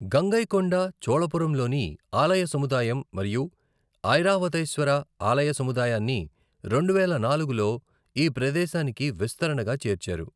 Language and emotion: Telugu, neutral